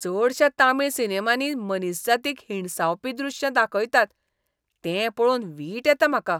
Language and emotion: Goan Konkani, disgusted